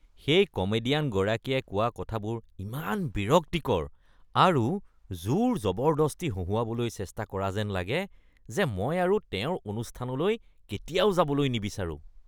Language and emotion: Assamese, disgusted